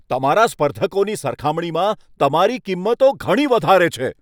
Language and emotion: Gujarati, angry